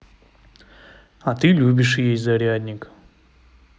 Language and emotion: Russian, neutral